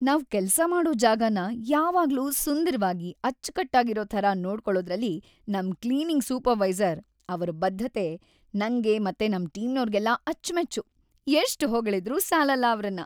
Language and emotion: Kannada, happy